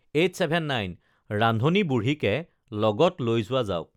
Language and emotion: Assamese, neutral